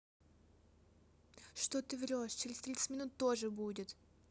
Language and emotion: Russian, angry